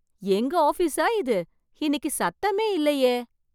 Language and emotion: Tamil, surprised